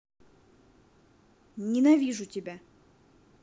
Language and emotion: Russian, angry